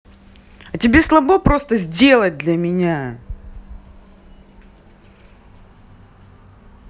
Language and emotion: Russian, angry